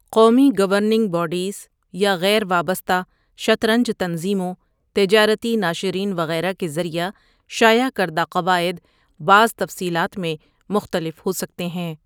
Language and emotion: Urdu, neutral